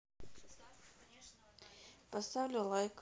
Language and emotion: Russian, neutral